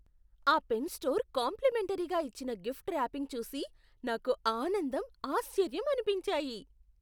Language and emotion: Telugu, surprised